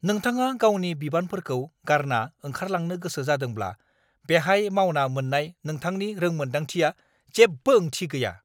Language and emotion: Bodo, angry